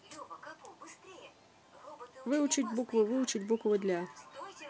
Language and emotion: Russian, neutral